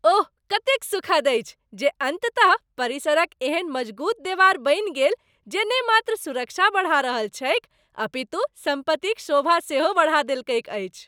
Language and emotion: Maithili, happy